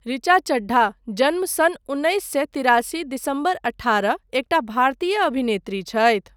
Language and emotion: Maithili, neutral